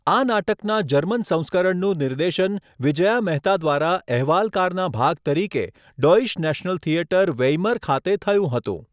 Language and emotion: Gujarati, neutral